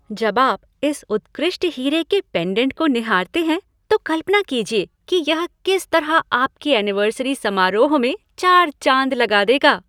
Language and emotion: Hindi, happy